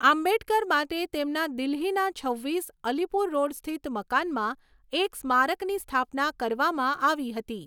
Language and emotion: Gujarati, neutral